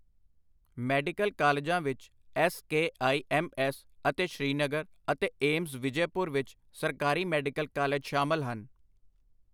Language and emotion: Punjabi, neutral